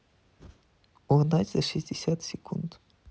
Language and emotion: Russian, neutral